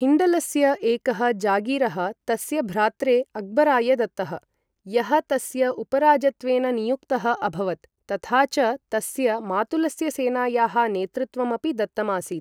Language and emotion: Sanskrit, neutral